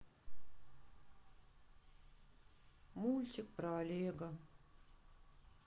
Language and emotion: Russian, sad